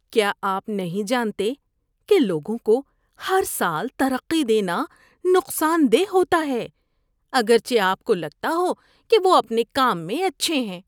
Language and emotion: Urdu, disgusted